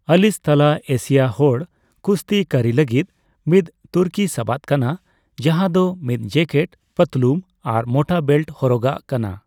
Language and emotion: Santali, neutral